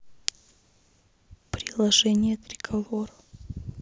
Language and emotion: Russian, neutral